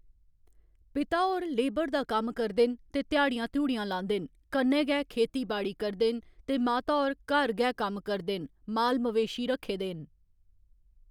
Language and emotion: Dogri, neutral